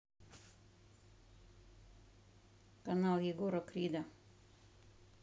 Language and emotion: Russian, neutral